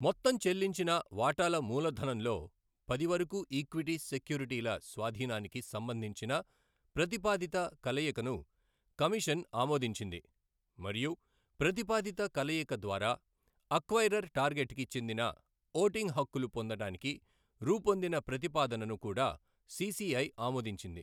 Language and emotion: Telugu, neutral